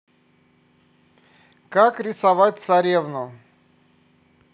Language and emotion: Russian, neutral